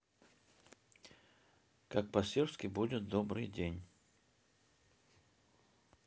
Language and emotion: Russian, neutral